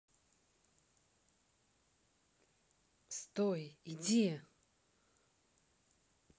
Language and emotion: Russian, neutral